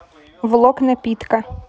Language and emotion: Russian, neutral